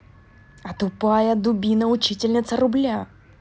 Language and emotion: Russian, angry